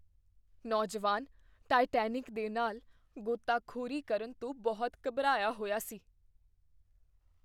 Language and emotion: Punjabi, fearful